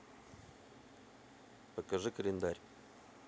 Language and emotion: Russian, neutral